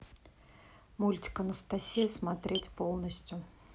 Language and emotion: Russian, neutral